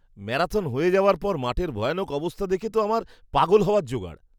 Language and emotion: Bengali, disgusted